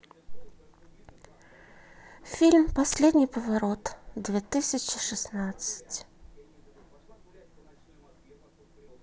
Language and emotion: Russian, sad